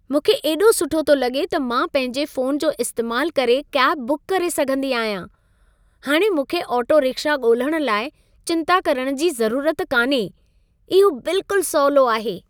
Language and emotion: Sindhi, happy